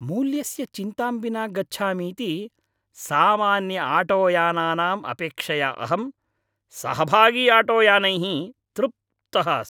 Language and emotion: Sanskrit, happy